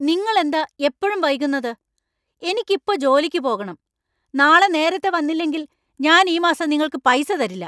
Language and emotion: Malayalam, angry